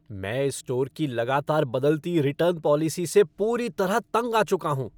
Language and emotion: Hindi, angry